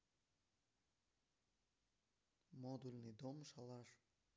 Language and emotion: Russian, neutral